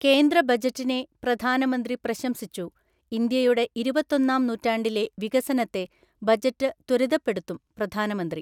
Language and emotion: Malayalam, neutral